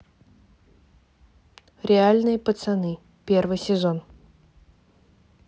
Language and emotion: Russian, neutral